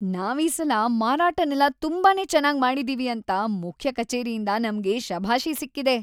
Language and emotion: Kannada, happy